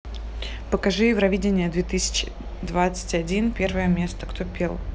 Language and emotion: Russian, neutral